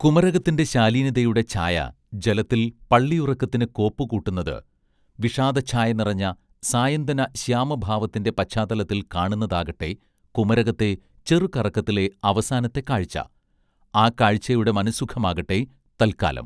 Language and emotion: Malayalam, neutral